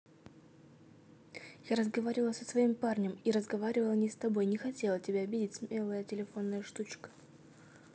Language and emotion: Russian, neutral